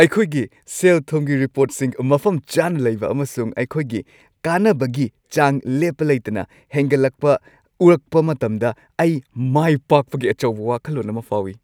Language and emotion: Manipuri, happy